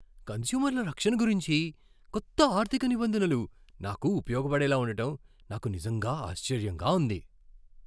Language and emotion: Telugu, surprised